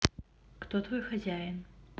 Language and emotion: Russian, neutral